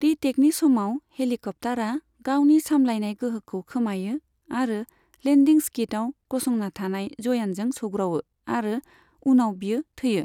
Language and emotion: Bodo, neutral